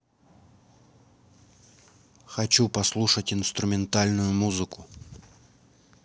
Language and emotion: Russian, neutral